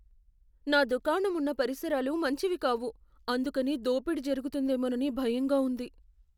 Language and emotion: Telugu, fearful